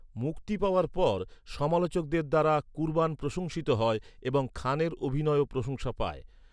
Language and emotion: Bengali, neutral